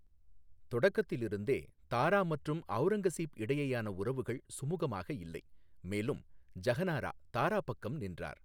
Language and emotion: Tamil, neutral